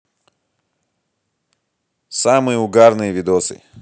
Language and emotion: Russian, positive